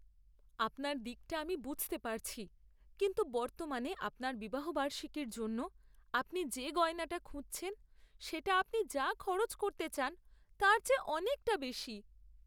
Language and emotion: Bengali, sad